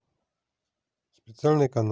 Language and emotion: Russian, neutral